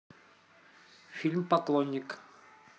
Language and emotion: Russian, neutral